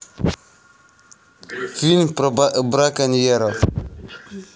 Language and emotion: Russian, neutral